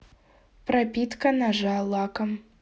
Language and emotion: Russian, neutral